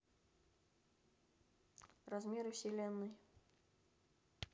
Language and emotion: Russian, neutral